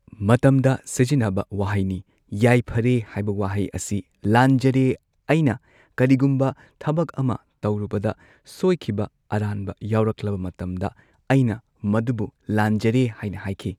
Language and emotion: Manipuri, neutral